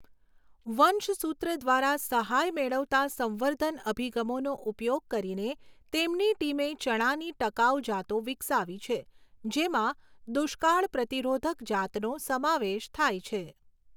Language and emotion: Gujarati, neutral